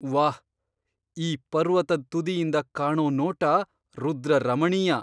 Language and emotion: Kannada, surprised